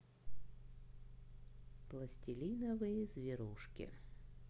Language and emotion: Russian, neutral